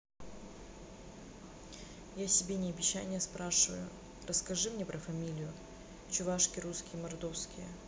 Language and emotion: Russian, neutral